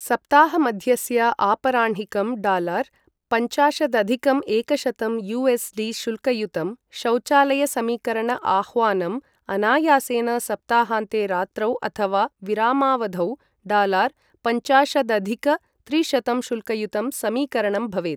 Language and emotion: Sanskrit, neutral